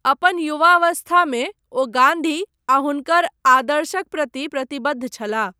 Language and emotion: Maithili, neutral